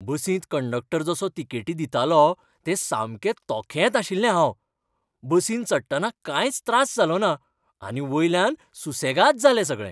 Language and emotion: Goan Konkani, happy